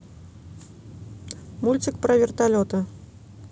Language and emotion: Russian, neutral